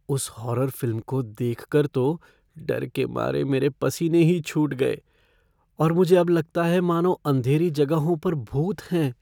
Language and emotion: Hindi, fearful